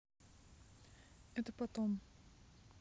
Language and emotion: Russian, neutral